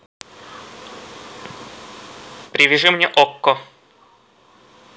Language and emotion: Russian, neutral